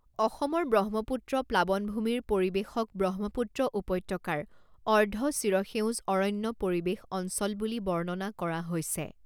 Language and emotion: Assamese, neutral